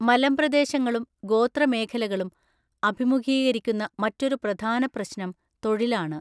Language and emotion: Malayalam, neutral